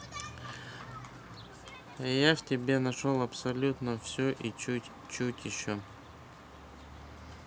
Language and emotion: Russian, neutral